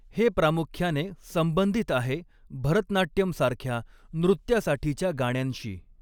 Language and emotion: Marathi, neutral